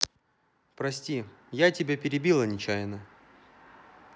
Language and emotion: Russian, neutral